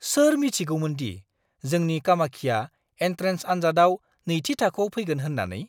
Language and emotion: Bodo, surprised